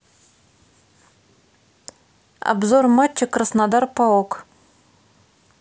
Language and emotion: Russian, neutral